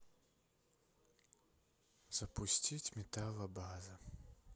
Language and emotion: Russian, sad